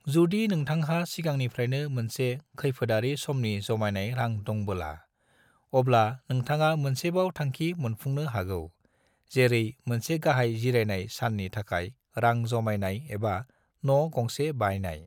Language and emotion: Bodo, neutral